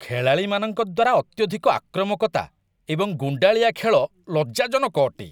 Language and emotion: Odia, disgusted